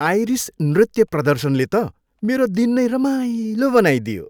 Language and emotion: Nepali, happy